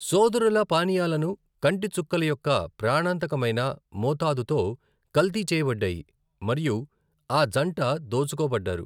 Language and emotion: Telugu, neutral